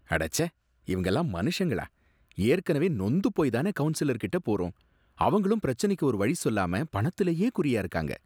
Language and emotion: Tamil, disgusted